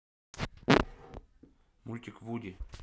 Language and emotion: Russian, neutral